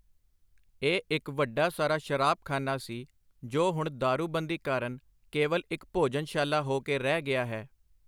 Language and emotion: Punjabi, neutral